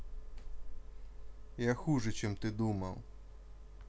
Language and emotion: Russian, neutral